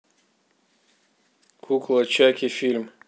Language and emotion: Russian, neutral